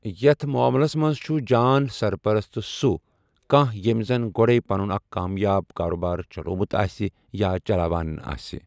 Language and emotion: Kashmiri, neutral